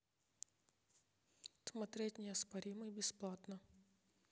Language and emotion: Russian, neutral